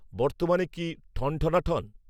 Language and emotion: Bengali, neutral